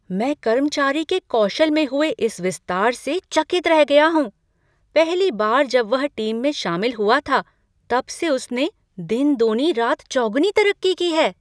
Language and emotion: Hindi, surprised